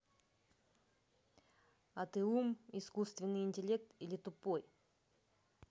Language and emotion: Russian, neutral